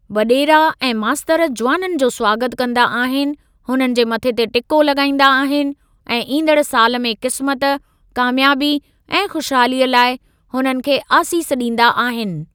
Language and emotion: Sindhi, neutral